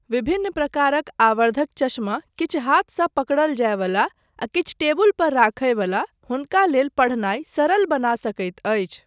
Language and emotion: Maithili, neutral